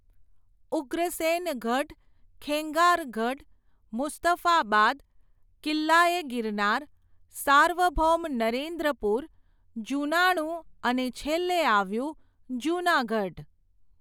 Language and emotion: Gujarati, neutral